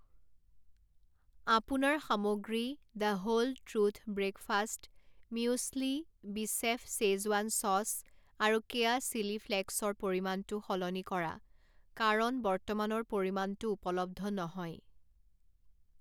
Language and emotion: Assamese, neutral